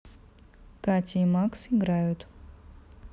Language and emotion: Russian, neutral